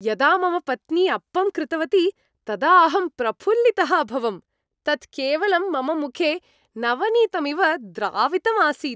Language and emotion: Sanskrit, happy